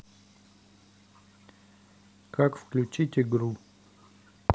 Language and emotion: Russian, neutral